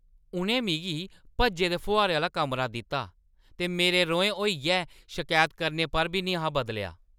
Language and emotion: Dogri, angry